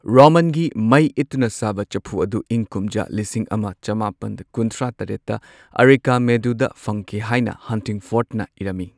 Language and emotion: Manipuri, neutral